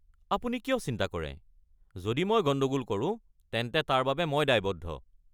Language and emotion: Assamese, angry